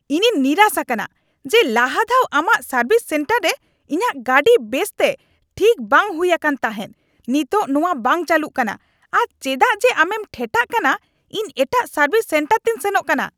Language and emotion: Santali, angry